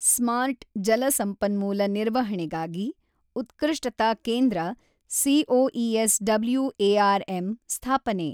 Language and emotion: Kannada, neutral